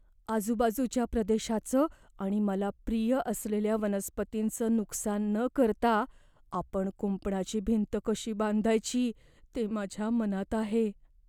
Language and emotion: Marathi, fearful